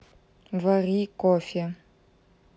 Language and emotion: Russian, neutral